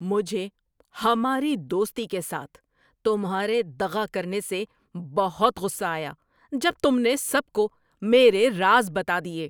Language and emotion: Urdu, angry